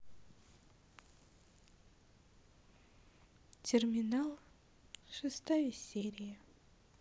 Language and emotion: Russian, sad